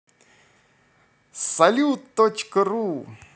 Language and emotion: Russian, positive